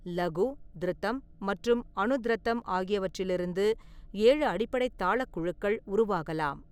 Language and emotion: Tamil, neutral